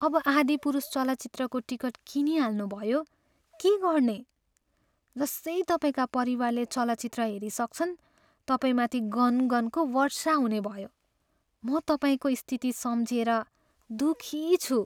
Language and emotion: Nepali, sad